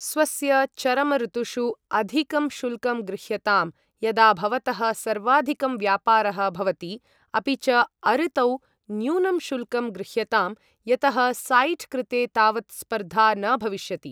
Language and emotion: Sanskrit, neutral